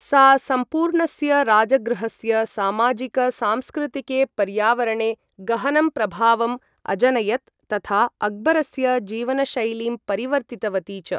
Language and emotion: Sanskrit, neutral